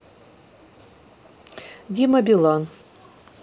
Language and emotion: Russian, neutral